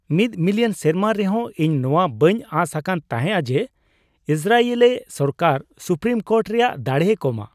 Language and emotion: Santali, surprised